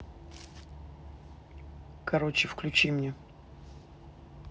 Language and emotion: Russian, angry